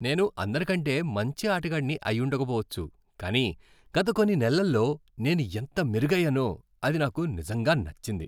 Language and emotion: Telugu, happy